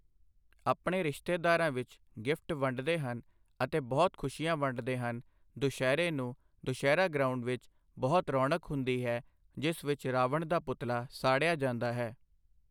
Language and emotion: Punjabi, neutral